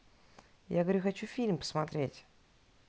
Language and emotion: Russian, neutral